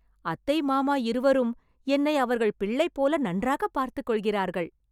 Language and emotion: Tamil, happy